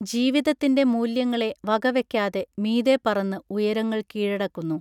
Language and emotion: Malayalam, neutral